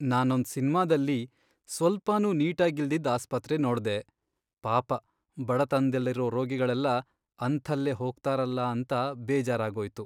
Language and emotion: Kannada, sad